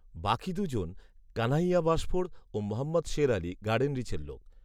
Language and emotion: Bengali, neutral